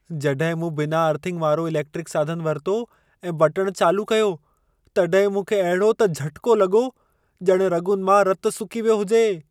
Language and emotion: Sindhi, fearful